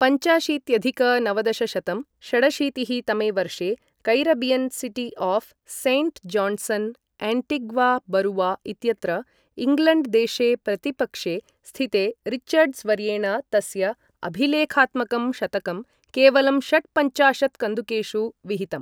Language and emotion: Sanskrit, neutral